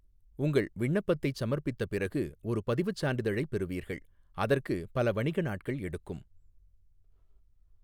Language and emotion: Tamil, neutral